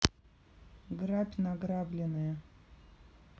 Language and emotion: Russian, neutral